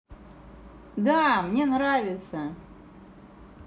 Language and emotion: Russian, positive